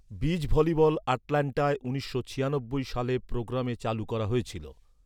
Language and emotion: Bengali, neutral